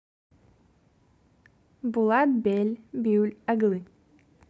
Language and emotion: Russian, positive